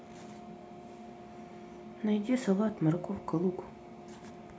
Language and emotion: Russian, neutral